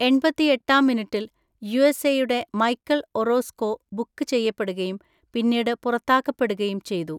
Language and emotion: Malayalam, neutral